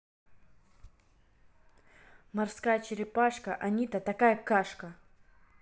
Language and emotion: Russian, neutral